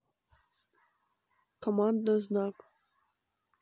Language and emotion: Russian, neutral